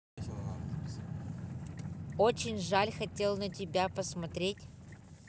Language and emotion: Russian, neutral